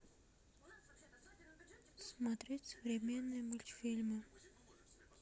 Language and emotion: Russian, sad